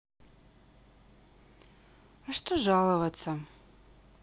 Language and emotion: Russian, sad